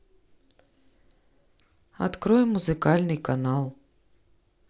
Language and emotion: Russian, neutral